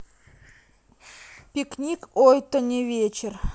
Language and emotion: Russian, neutral